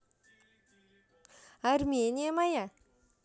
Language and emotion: Russian, positive